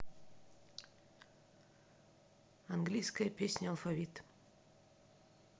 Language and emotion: Russian, neutral